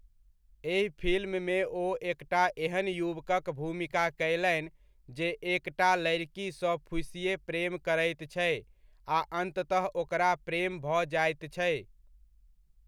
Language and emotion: Maithili, neutral